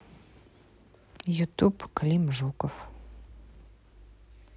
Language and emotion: Russian, neutral